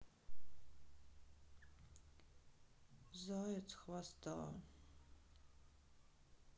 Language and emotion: Russian, sad